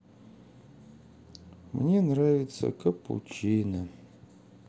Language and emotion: Russian, sad